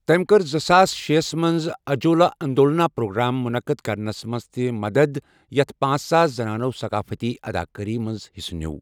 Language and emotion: Kashmiri, neutral